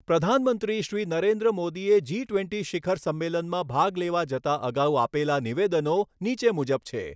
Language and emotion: Gujarati, neutral